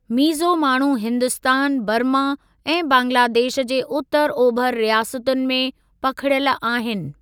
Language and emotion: Sindhi, neutral